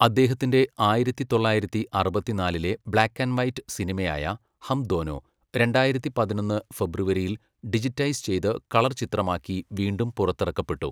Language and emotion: Malayalam, neutral